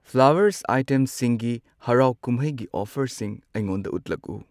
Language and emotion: Manipuri, neutral